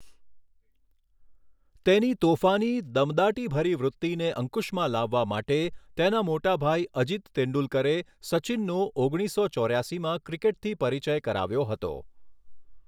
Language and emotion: Gujarati, neutral